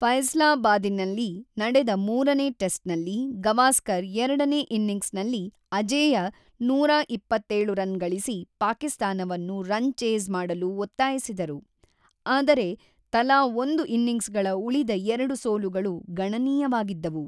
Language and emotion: Kannada, neutral